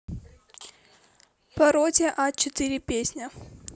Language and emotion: Russian, neutral